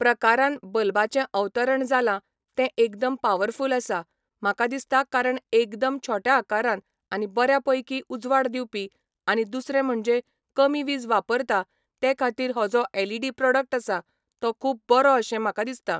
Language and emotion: Goan Konkani, neutral